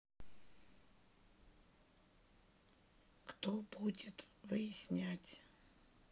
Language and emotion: Russian, neutral